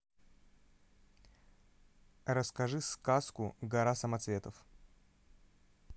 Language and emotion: Russian, neutral